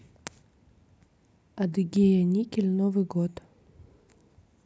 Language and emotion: Russian, neutral